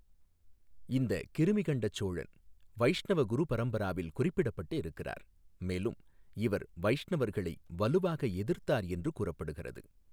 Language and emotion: Tamil, neutral